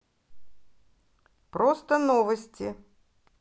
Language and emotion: Russian, neutral